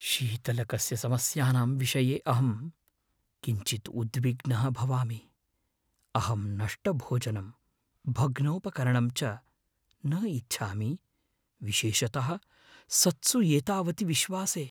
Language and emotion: Sanskrit, fearful